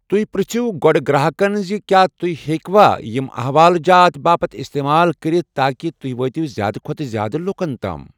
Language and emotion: Kashmiri, neutral